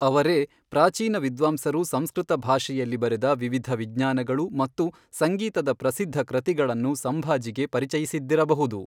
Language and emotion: Kannada, neutral